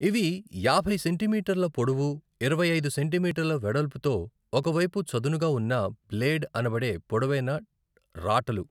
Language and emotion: Telugu, neutral